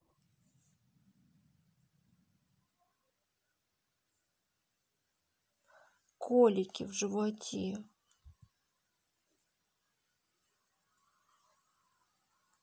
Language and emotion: Russian, sad